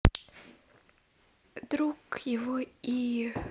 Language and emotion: Russian, sad